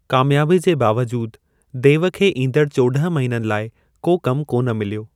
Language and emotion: Sindhi, neutral